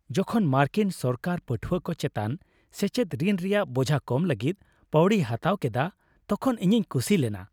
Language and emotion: Santali, happy